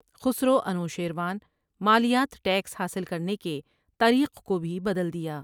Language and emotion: Urdu, neutral